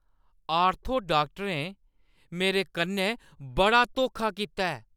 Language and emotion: Dogri, angry